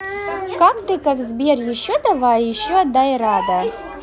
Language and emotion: Russian, neutral